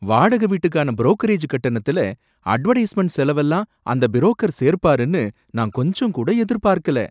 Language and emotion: Tamil, surprised